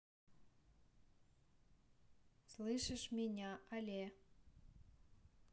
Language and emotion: Russian, neutral